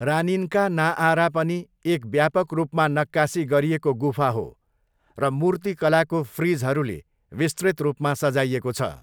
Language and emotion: Nepali, neutral